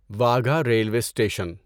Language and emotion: Urdu, neutral